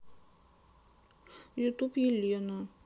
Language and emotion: Russian, sad